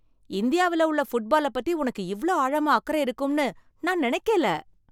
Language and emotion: Tamil, surprised